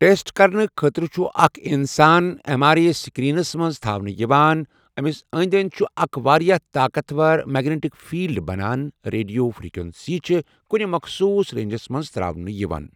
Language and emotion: Kashmiri, neutral